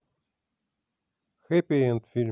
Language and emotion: Russian, neutral